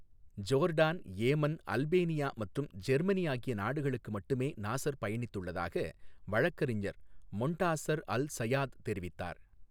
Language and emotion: Tamil, neutral